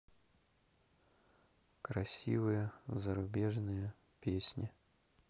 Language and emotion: Russian, sad